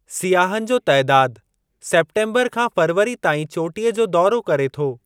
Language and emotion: Sindhi, neutral